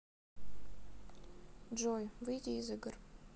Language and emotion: Russian, sad